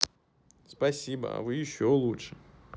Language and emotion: Russian, positive